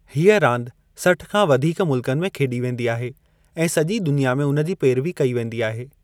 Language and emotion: Sindhi, neutral